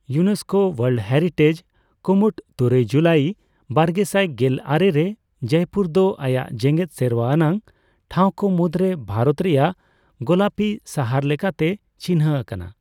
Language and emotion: Santali, neutral